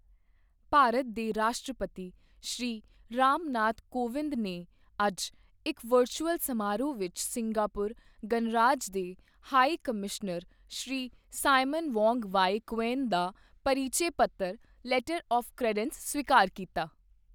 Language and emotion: Punjabi, neutral